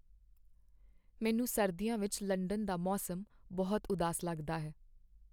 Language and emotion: Punjabi, sad